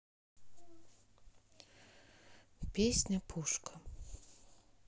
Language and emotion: Russian, neutral